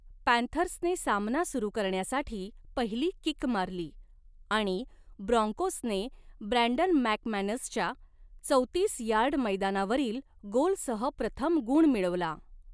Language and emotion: Marathi, neutral